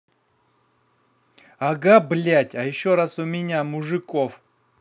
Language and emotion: Russian, angry